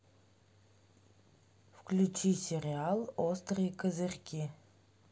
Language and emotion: Russian, neutral